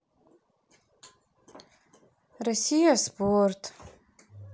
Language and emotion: Russian, sad